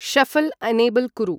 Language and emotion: Sanskrit, neutral